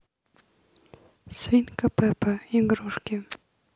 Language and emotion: Russian, neutral